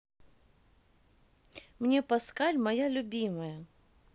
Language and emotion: Russian, neutral